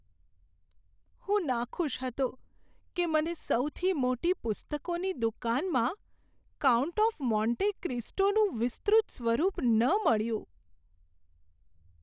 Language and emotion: Gujarati, sad